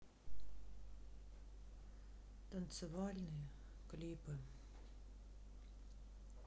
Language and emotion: Russian, sad